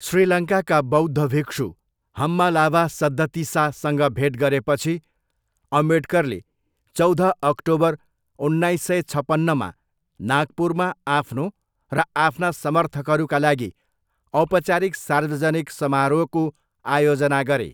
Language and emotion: Nepali, neutral